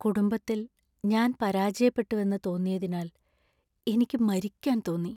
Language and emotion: Malayalam, sad